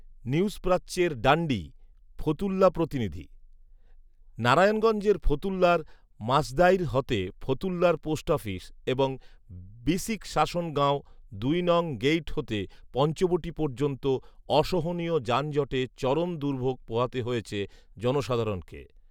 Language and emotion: Bengali, neutral